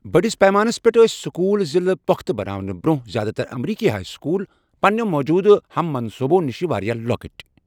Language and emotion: Kashmiri, neutral